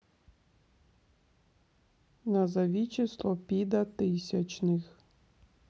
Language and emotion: Russian, neutral